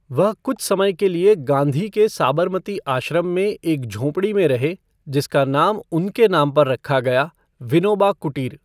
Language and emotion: Hindi, neutral